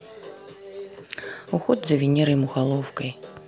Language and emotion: Russian, neutral